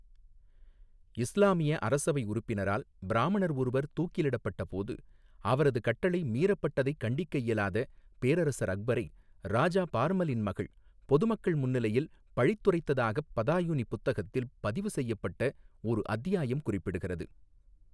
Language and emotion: Tamil, neutral